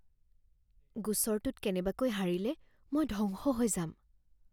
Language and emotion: Assamese, fearful